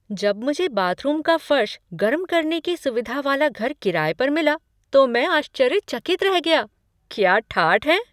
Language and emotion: Hindi, surprised